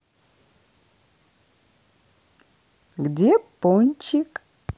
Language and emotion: Russian, positive